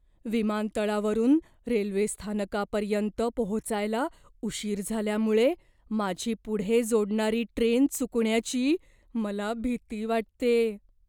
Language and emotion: Marathi, fearful